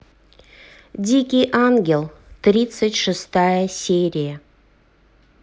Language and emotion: Russian, neutral